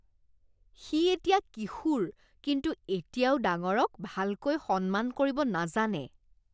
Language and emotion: Assamese, disgusted